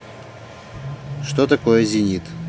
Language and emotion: Russian, neutral